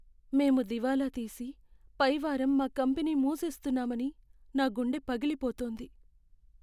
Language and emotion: Telugu, sad